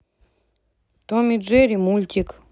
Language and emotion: Russian, neutral